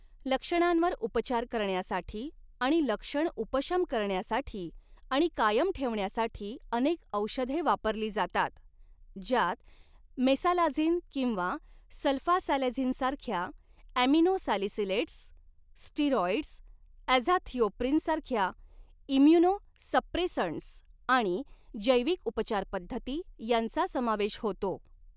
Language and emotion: Marathi, neutral